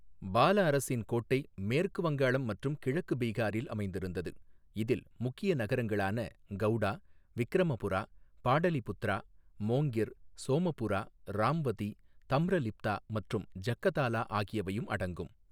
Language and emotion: Tamil, neutral